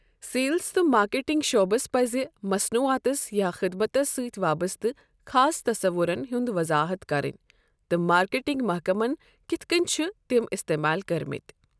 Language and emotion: Kashmiri, neutral